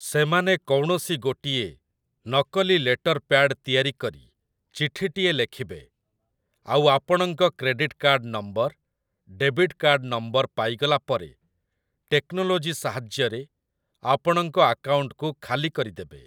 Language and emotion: Odia, neutral